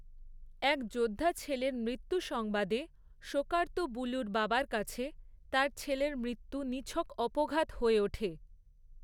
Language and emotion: Bengali, neutral